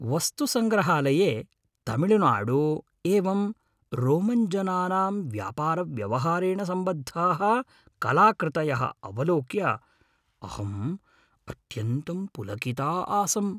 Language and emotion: Sanskrit, happy